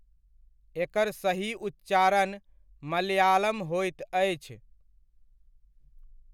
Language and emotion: Maithili, neutral